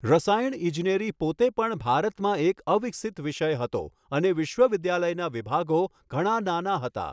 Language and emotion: Gujarati, neutral